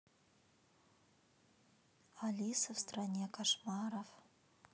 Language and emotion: Russian, neutral